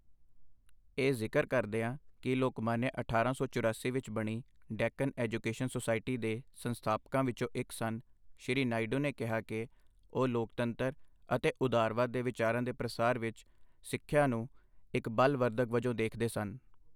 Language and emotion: Punjabi, neutral